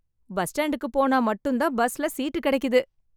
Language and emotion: Tamil, happy